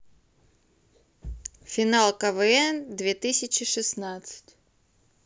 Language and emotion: Russian, neutral